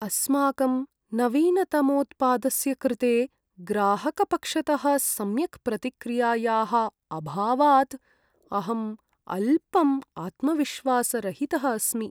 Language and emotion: Sanskrit, sad